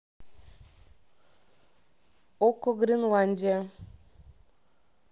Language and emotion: Russian, neutral